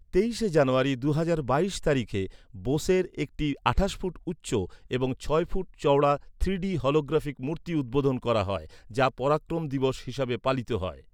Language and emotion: Bengali, neutral